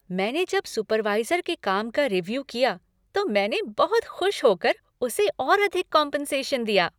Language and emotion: Hindi, happy